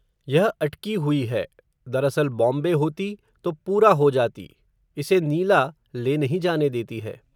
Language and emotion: Hindi, neutral